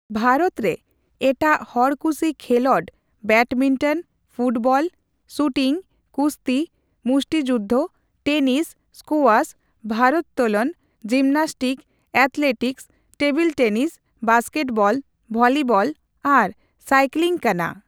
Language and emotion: Santali, neutral